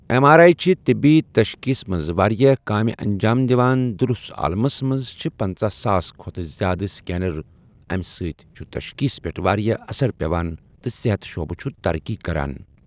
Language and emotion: Kashmiri, neutral